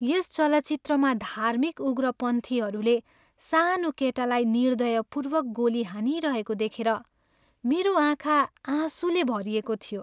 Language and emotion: Nepali, sad